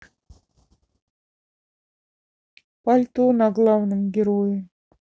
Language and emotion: Russian, sad